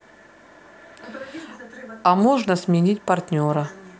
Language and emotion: Russian, neutral